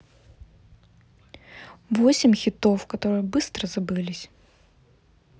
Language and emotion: Russian, neutral